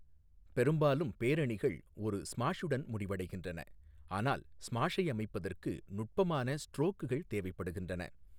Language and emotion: Tamil, neutral